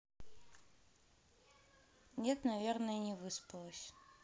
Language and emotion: Russian, neutral